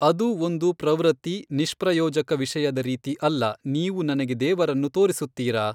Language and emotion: Kannada, neutral